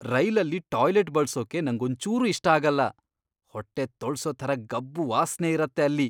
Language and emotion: Kannada, disgusted